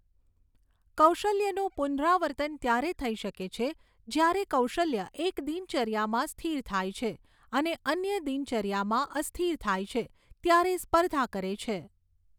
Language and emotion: Gujarati, neutral